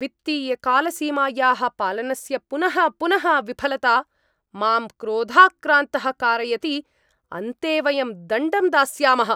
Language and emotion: Sanskrit, angry